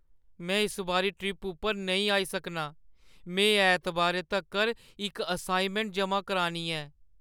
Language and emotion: Dogri, sad